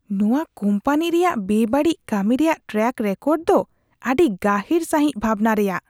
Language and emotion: Santali, disgusted